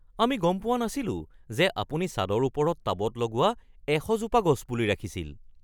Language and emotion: Assamese, surprised